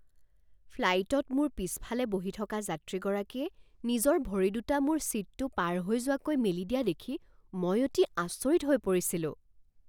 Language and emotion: Assamese, surprised